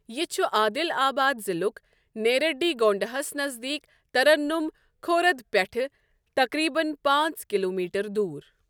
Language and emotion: Kashmiri, neutral